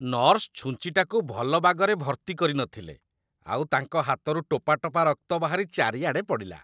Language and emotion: Odia, disgusted